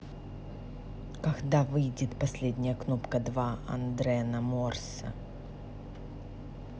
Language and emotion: Russian, neutral